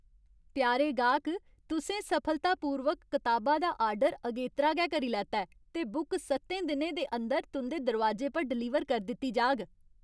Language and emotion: Dogri, happy